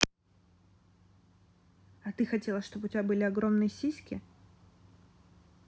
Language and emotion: Russian, neutral